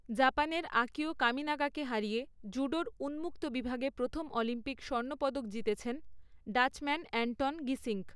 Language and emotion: Bengali, neutral